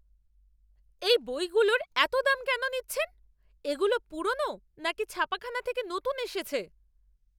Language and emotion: Bengali, angry